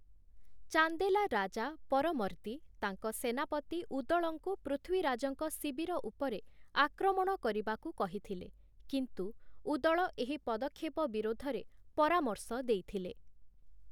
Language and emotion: Odia, neutral